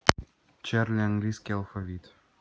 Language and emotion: Russian, neutral